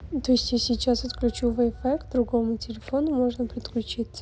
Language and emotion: Russian, neutral